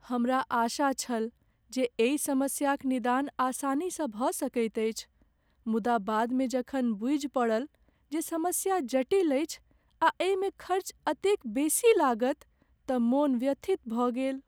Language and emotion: Maithili, sad